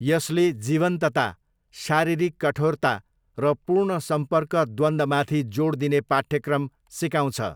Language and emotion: Nepali, neutral